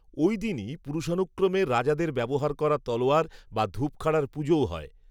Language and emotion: Bengali, neutral